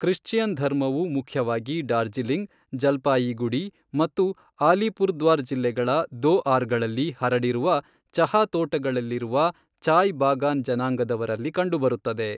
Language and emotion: Kannada, neutral